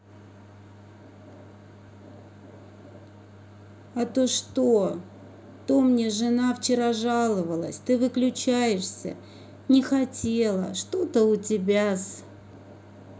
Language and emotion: Russian, sad